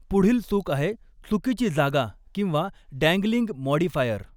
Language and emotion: Marathi, neutral